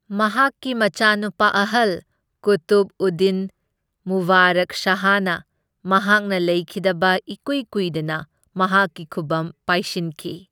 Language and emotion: Manipuri, neutral